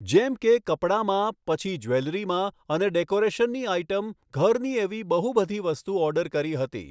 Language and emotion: Gujarati, neutral